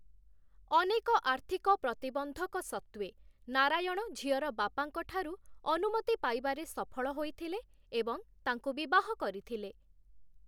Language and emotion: Odia, neutral